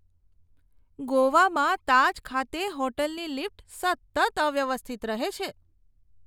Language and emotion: Gujarati, disgusted